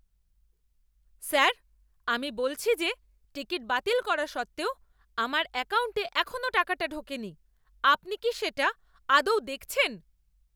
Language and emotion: Bengali, angry